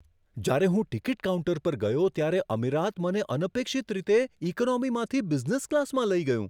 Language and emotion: Gujarati, surprised